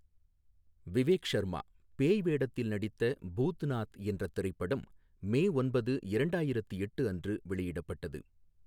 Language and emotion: Tamil, neutral